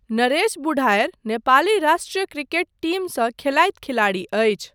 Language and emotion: Maithili, neutral